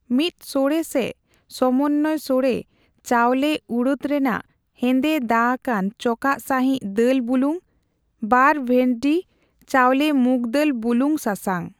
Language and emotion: Santali, neutral